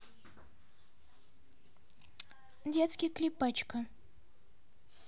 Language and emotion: Russian, neutral